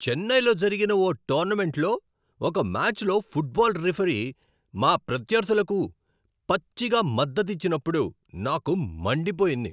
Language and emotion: Telugu, angry